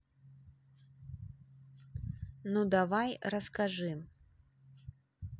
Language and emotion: Russian, neutral